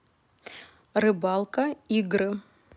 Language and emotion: Russian, neutral